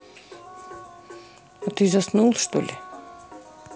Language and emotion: Russian, neutral